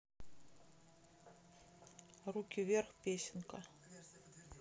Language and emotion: Russian, neutral